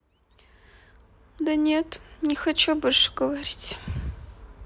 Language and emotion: Russian, sad